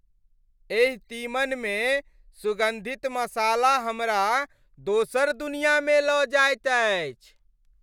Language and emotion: Maithili, happy